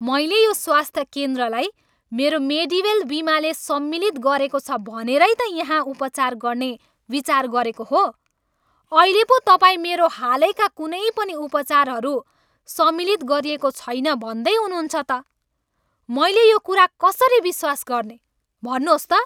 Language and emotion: Nepali, angry